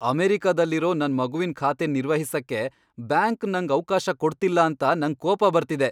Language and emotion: Kannada, angry